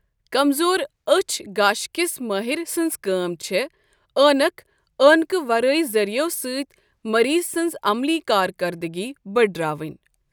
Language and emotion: Kashmiri, neutral